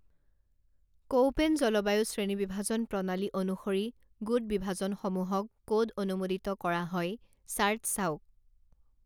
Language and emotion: Assamese, neutral